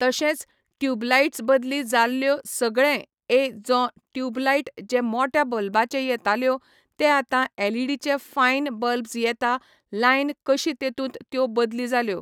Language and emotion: Goan Konkani, neutral